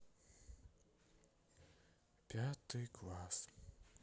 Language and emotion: Russian, sad